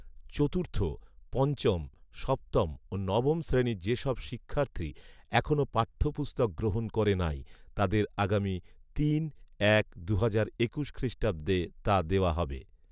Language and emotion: Bengali, neutral